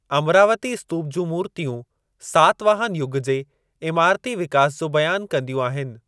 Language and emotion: Sindhi, neutral